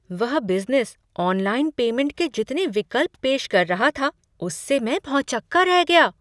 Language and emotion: Hindi, surprised